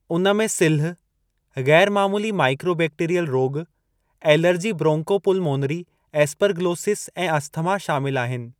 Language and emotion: Sindhi, neutral